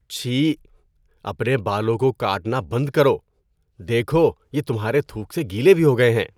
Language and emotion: Urdu, disgusted